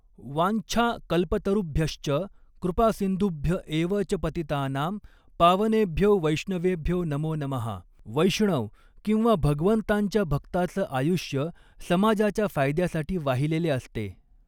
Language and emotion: Marathi, neutral